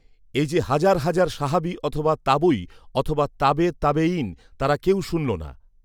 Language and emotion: Bengali, neutral